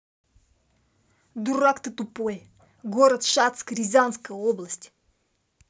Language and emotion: Russian, angry